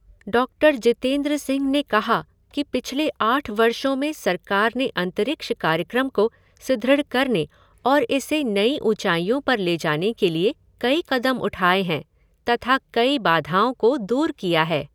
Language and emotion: Hindi, neutral